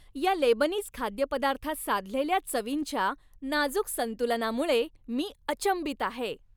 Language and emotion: Marathi, happy